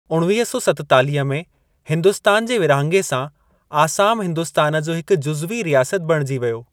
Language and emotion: Sindhi, neutral